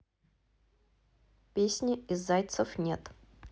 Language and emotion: Russian, neutral